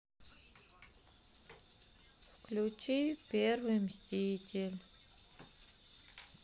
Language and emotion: Russian, sad